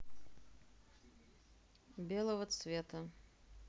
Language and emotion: Russian, neutral